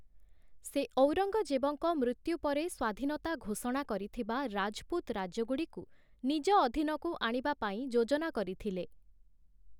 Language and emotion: Odia, neutral